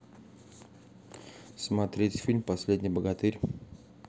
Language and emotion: Russian, neutral